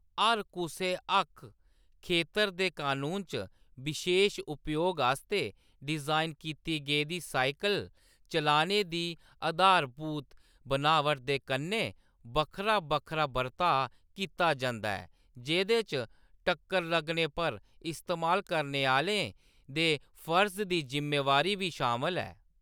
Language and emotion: Dogri, neutral